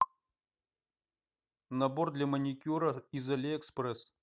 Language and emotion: Russian, neutral